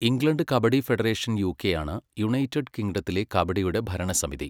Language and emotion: Malayalam, neutral